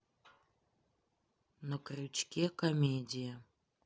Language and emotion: Russian, neutral